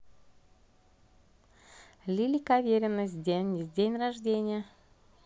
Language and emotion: Russian, positive